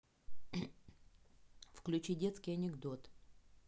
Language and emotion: Russian, neutral